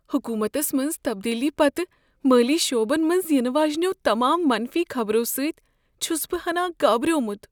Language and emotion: Kashmiri, fearful